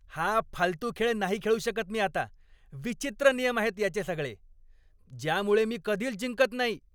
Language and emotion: Marathi, angry